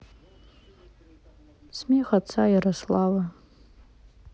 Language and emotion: Russian, sad